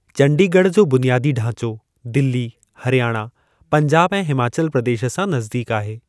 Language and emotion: Sindhi, neutral